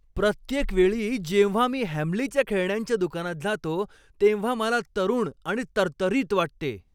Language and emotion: Marathi, happy